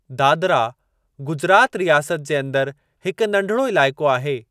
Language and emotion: Sindhi, neutral